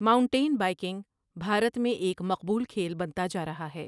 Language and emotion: Urdu, neutral